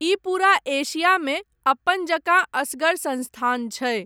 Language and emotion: Maithili, neutral